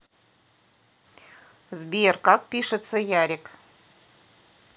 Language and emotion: Russian, neutral